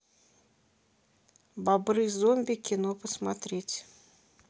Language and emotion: Russian, neutral